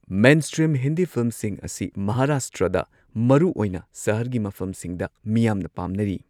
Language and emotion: Manipuri, neutral